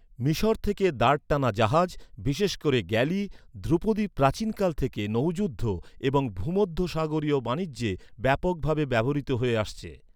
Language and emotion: Bengali, neutral